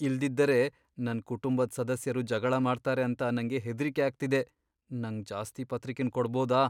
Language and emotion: Kannada, fearful